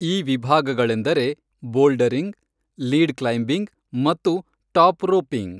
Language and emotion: Kannada, neutral